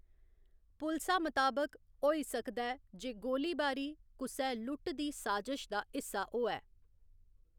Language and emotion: Dogri, neutral